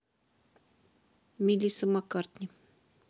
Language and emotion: Russian, neutral